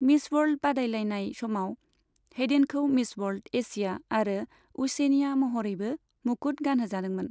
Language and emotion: Bodo, neutral